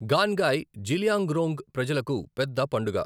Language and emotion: Telugu, neutral